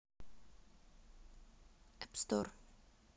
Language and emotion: Russian, neutral